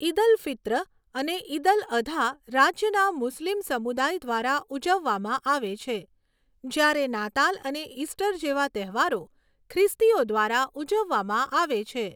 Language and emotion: Gujarati, neutral